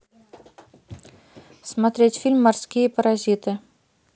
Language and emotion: Russian, neutral